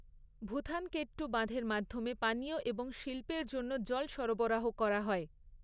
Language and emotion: Bengali, neutral